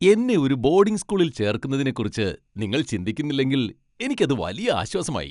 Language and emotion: Malayalam, happy